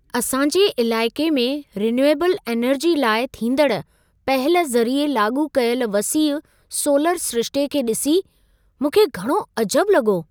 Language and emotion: Sindhi, surprised